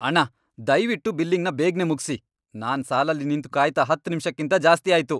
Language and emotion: Kannada, angry